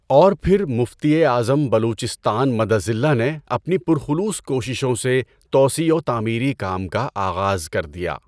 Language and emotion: Urdu, neutral